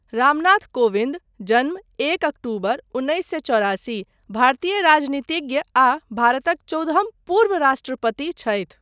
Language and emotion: Maithili, neutral